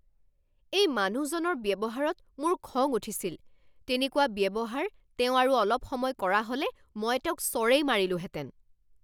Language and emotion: Assamese, angry